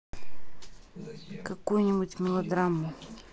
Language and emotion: Russian, neutral